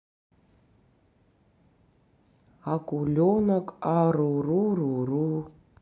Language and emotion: Russian, neutral